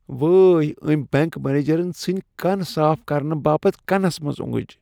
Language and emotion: Kashmiri, disgusted